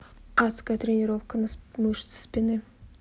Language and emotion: Russian, neutral